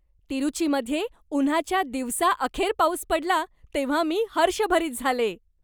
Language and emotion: Marathi, happy